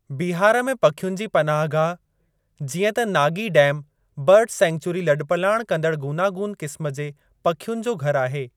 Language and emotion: Sindhi, neutral